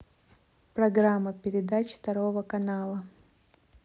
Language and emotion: Russian, neutral